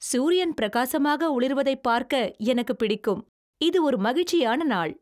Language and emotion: Tamil, happy